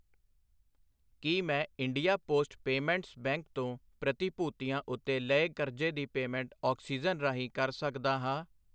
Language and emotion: Punjabi, neutral